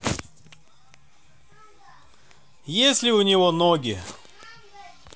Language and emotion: Russian, neutral